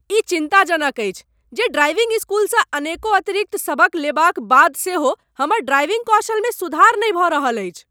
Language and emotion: Maithili, angry